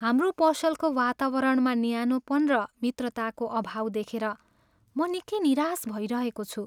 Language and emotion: Nepali, sad